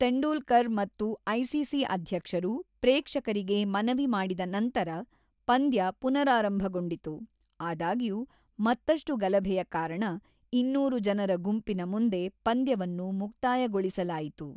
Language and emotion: Kannada, neutral